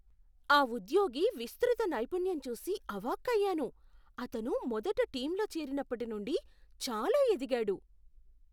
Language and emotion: Telugu, surprised